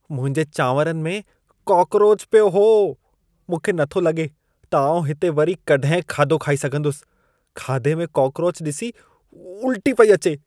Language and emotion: Sindhi, disgusted